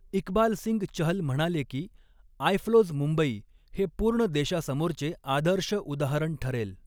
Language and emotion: Marathi, neutral